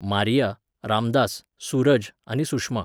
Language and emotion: Goan Konkani, neutral